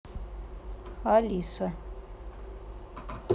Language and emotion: Russian, neutral